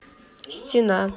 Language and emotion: Russian, neutral